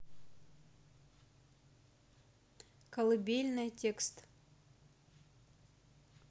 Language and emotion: Russian, neutral